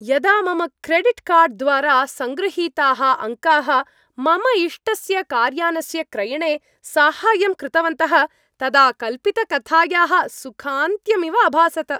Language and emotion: Sanskrit, happy